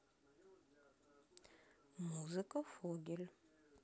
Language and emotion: Russian, neutral